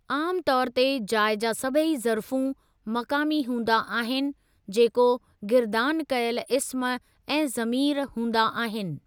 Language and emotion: Sindhi, neutral